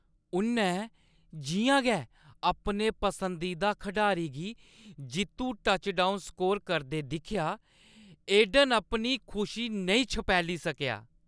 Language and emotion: Dogri, happy